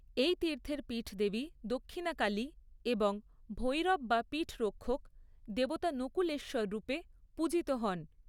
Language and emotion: Bengali, neutral